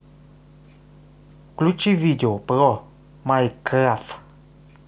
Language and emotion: Russian, neutral